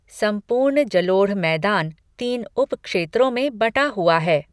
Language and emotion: Hindi, neutral